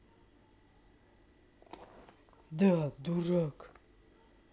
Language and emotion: Russian, angry